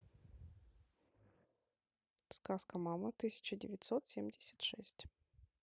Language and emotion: Russian, neutral